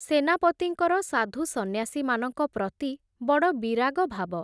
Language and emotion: Odia, neutral